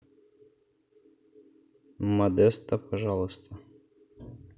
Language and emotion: Russian, neutral